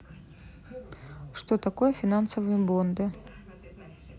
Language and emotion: Russian, neutral